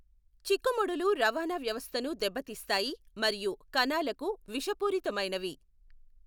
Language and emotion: Telugu, neutral